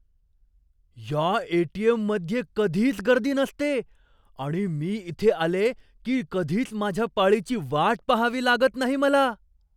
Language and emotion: Marathi, surprised